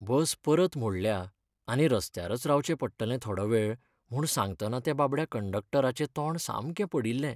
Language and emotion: Goan Konkani, sad